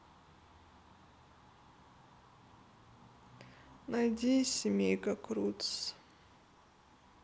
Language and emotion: Russian, sad